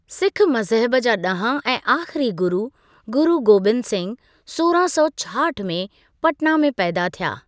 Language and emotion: Sindhi, neutral